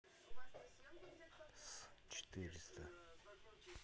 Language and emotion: Russian, neutral